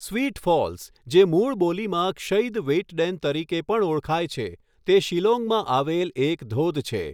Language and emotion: Gujarati, neutral